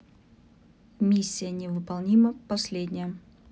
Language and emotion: Russian, neutral